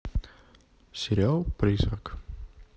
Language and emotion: Russian, neutral